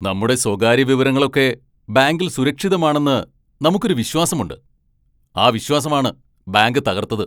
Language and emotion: Malayalam, angry